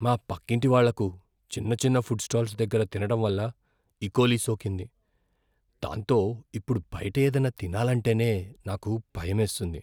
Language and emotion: Telugu, fearful